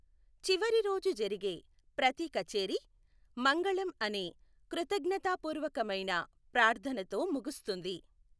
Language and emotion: Telugu, neutral